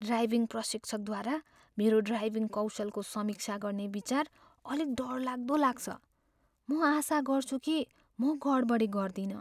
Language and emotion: Nepali, fearful